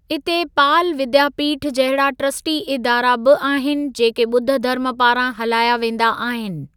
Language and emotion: Sindhi, neutral